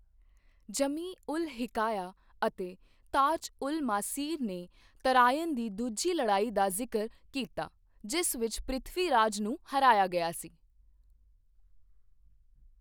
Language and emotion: Punjabi, neutral